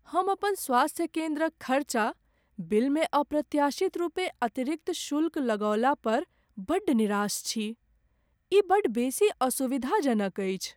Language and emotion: Maithili, sad